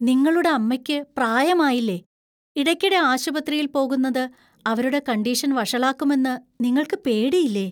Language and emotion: Malayalam, fearful